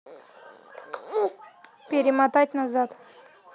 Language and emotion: Russian, neutral